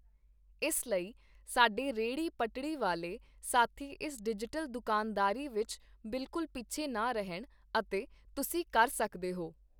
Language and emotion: Punjabi, neutral